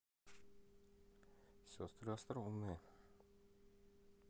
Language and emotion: Russian, neutral